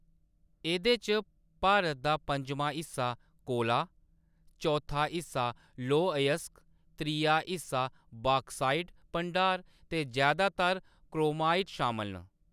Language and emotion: Dogri, neutral